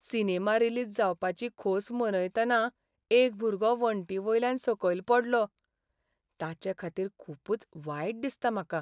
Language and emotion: Goan Konkani, sad